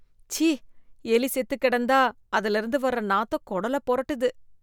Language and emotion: Tamil, disgusted